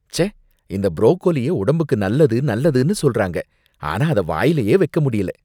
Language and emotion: Tamil, disgusted